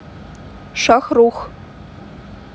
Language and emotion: Russian, neutral